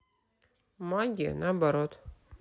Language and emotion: Russian, neutral